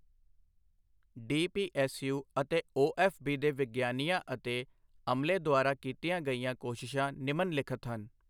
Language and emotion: Punjabi, neutral